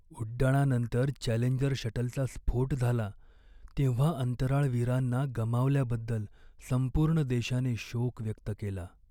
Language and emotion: Marathi, sad